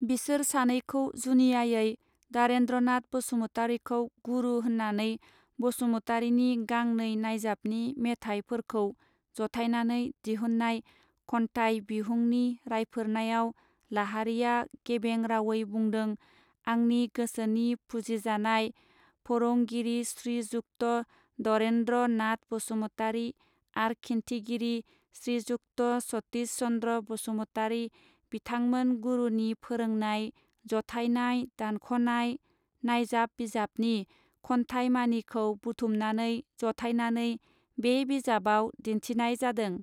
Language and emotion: Bodo, neutral